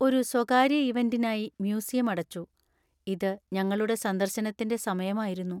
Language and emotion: Malayalam, sad